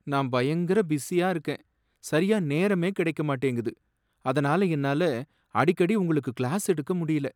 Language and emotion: Tamil, sad